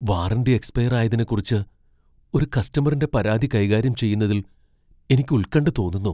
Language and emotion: Malayalam, fearful